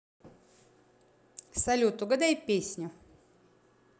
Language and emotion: Russian, positive